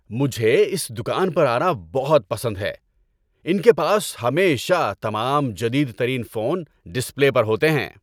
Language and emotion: Urdu, happy